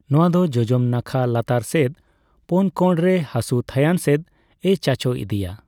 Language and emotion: Santali, neutral